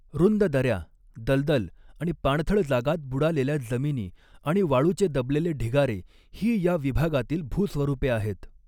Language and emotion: Marathi, neutral